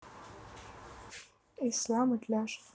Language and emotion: Russian, neutral